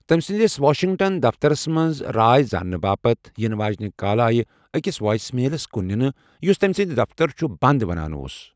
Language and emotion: Kashmiri, neutral